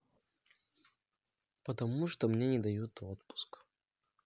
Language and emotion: Russian, sad